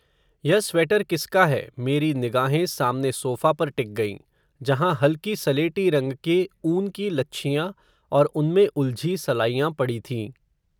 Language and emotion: Hindi, neutral